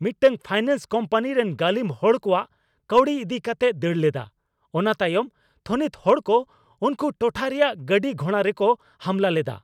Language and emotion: Santali, angry